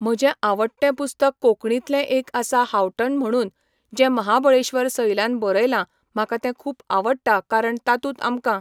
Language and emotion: Goan Konkani, neutral